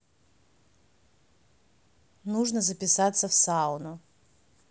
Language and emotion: Russian, neutral